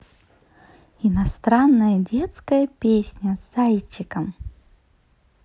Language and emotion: Russian, positive